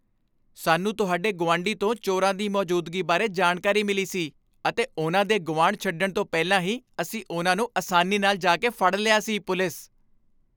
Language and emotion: Punjabi, happy